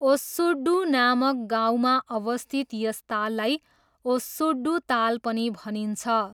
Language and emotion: Nepali, neutral